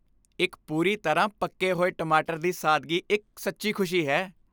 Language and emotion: Punjabi, happy